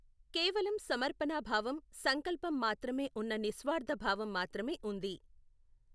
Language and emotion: Telugu, neutral